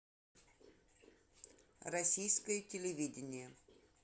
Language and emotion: Russian, neutral